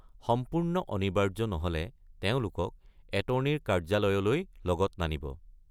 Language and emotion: Assamese, neutral